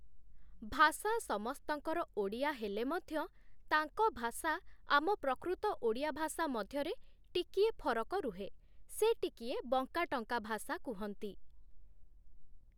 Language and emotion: Odia, neutral